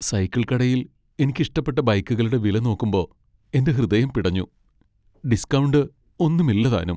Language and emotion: Malayalam, sad